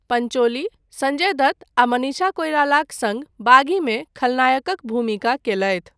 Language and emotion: Maithili, neutral